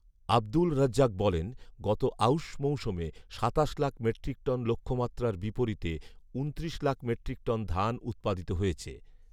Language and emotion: Bengali, neutral